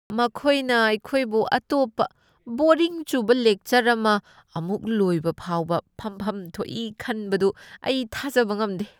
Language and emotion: Manipuri, disgusted